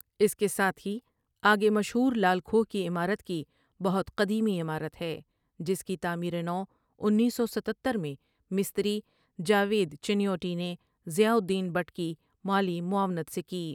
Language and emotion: Urdu, neutral